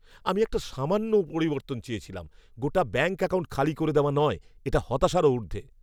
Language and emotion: Bengali, angry